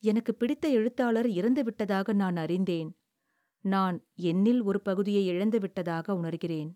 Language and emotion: Tamil, sad